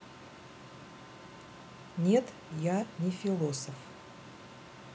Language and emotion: Russian, neutral